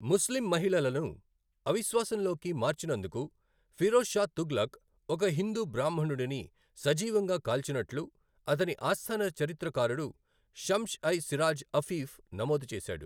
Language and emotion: Telugu, neutral